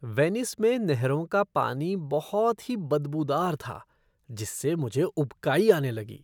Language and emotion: Hindi, disgusted